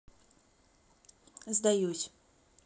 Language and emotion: Russian, neutral